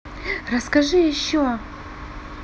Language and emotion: Russian, positive